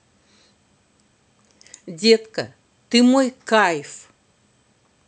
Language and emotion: Russian, positive